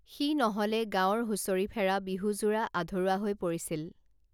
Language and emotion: Assamese, neutral